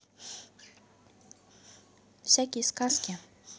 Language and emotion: Russian, neutral